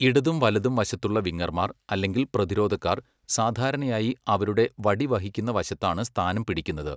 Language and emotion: Malayalam, neutral